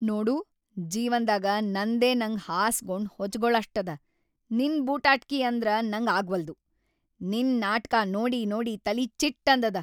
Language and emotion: Kannada, angry